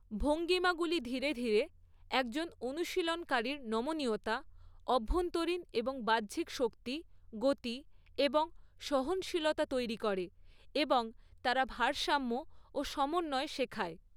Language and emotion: Bengali, neutral